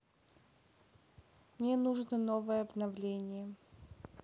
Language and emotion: Russian, sad